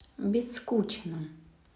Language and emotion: Russian, neutral